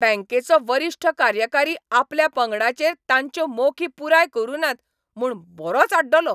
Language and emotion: Goan Konkani, angry